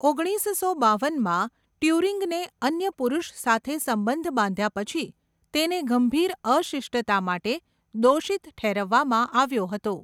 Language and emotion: Gujarati, neutral